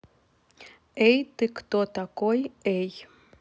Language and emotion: Russian, neutral